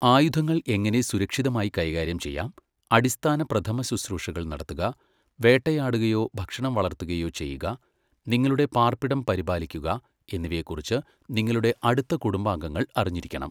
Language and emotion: Malayalam, neutral